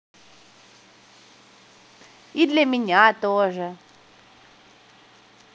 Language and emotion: Russian, positive